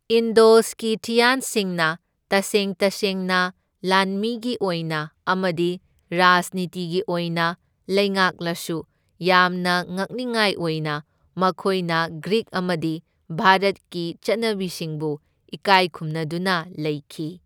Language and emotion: Manipuri, neutral